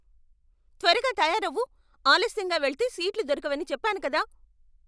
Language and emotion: Telugu, angry